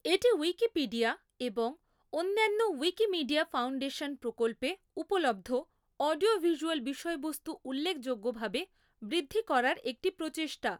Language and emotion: Bengali, neutral